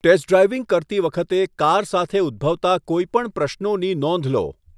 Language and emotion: Gujarati, neutral